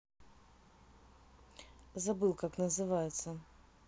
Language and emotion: Russian, neutral